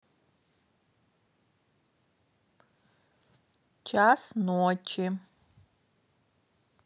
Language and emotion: Russian, neutral